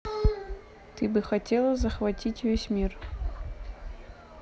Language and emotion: Russian, neutral